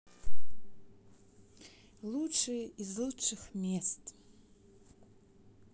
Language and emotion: Russian, neutral